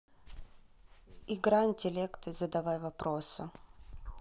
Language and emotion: Russian, neutral